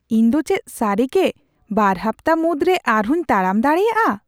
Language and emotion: Santali, surprised